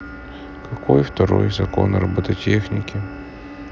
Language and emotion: Russian, sad